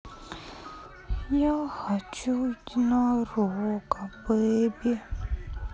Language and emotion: Russian, sad